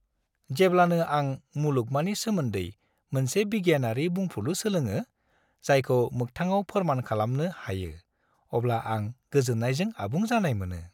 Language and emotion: Bodo, happy